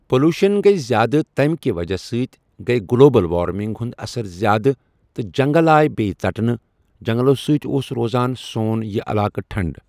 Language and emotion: Kashmiri, neutral